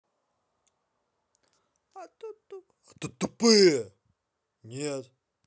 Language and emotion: Russian, angry